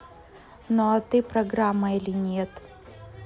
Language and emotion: Russian, neutral